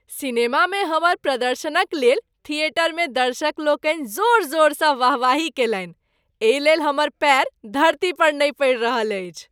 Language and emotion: Maithili, happy